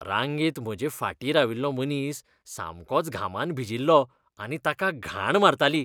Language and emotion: Goan Konkani, disgusted